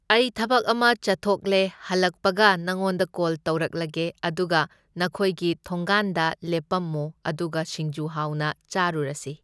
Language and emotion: Manipuri, neutral